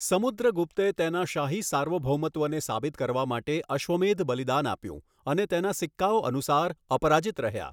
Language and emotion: Gujarati, neutral